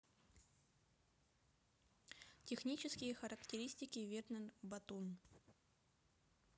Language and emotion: Russian, neutral